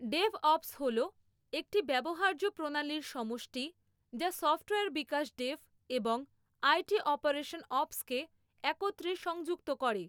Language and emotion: Bengali, neutral